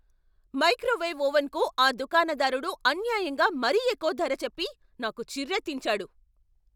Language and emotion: Telugu, angry